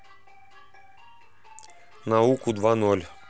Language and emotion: Russian, neutral